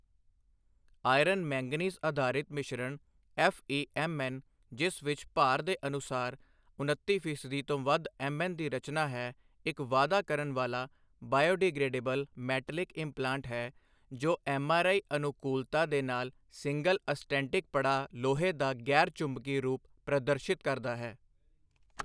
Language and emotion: Punjabi, neutral